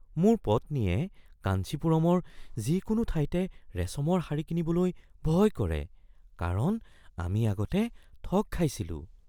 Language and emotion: Assamese, fearful